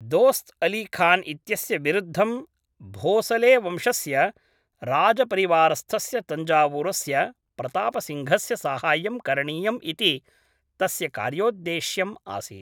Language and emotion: Sanskrit, neutral